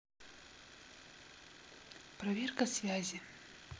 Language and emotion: Russian, neutral